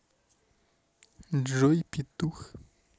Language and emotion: Russian, neutral